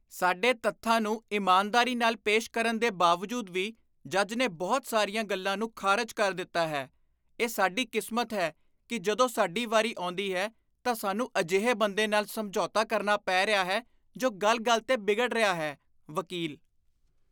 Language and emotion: Punjabi, disgusted